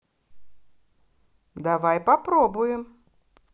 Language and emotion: Russian, positive